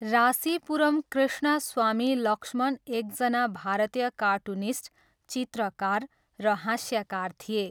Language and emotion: Nepali, neutral